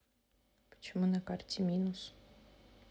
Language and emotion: Russian, neutral